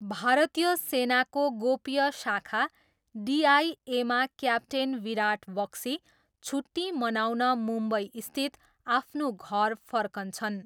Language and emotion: Nepali, neutral